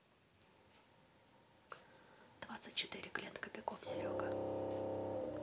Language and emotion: Russian, neutral